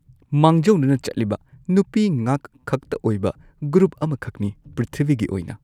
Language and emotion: Manipuri, neutral